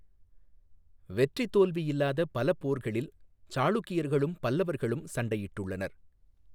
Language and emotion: Tamil, neutral